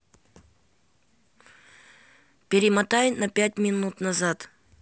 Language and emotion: Russian, neutral